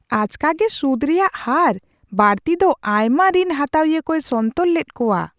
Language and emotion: Santali, surprised